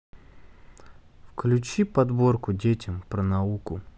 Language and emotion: Russian, neutral